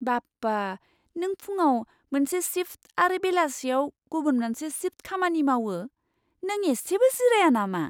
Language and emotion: Bodo, surprised